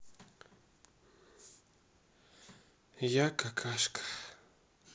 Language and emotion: Russian, sad